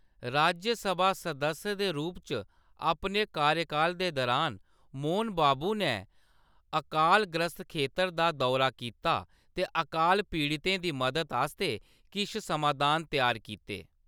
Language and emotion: Dogri, neutral